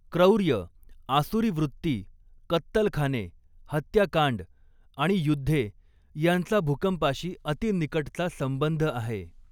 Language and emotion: Marathi, neutral